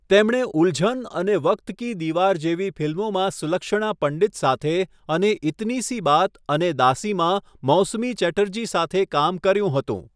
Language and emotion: Gujarati, neutral